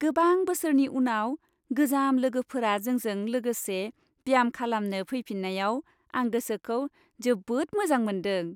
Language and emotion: Bodo, happy